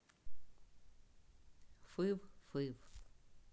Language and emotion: Russian, neutral